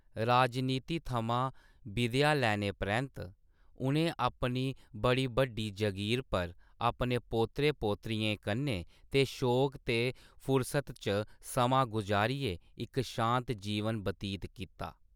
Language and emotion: Dogri, neutral